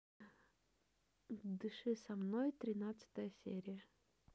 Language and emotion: Russian, neutral